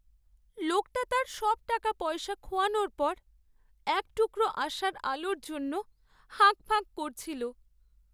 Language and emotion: Bengali, sad